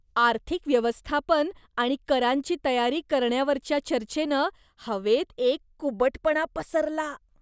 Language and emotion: Marathi, disgusted